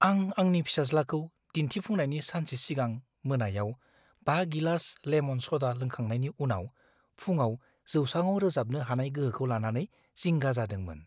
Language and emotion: Bodo, fearful